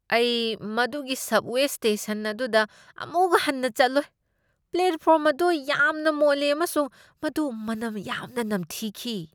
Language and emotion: Manipuri, disgusted